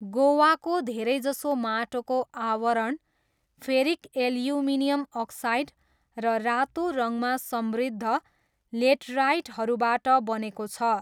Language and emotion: Nepali, neutral